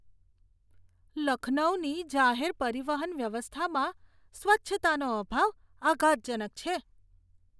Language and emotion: Gujarati, disgusted